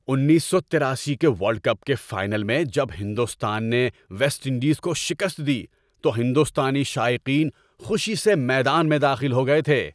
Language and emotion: Urdu, happy